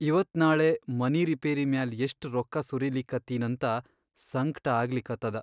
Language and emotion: Kannada, sad